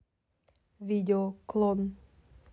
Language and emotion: Russian, neutral